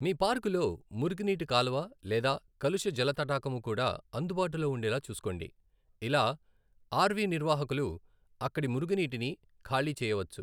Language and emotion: Telugu, neutral